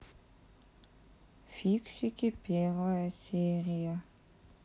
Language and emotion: Russian, sad